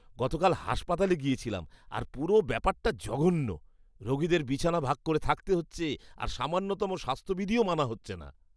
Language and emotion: Bengali, disgusted